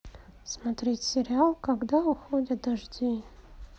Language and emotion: Russian, sad